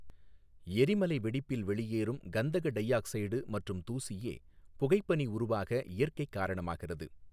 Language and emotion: Tamil, neutral